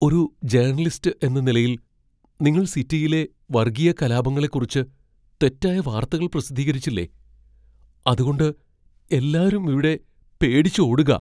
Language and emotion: Malayalam, fearful